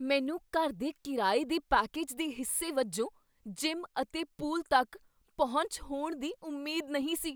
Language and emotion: Punjabi, surprised